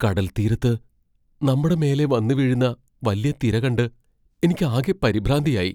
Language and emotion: Malayalam, fearful